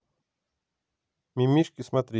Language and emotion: Russian, neutral